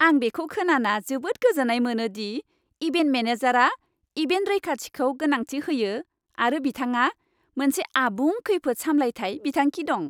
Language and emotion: Bodo, happy